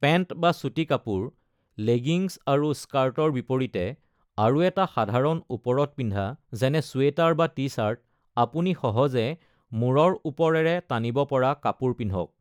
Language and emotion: Assamese, neutral